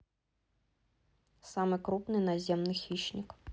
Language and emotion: Russian, neutral